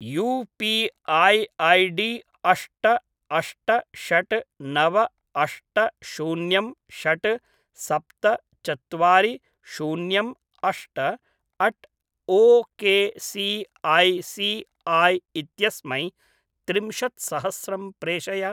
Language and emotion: Sanskrit, neutral